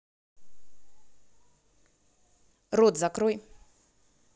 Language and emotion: Russian, angry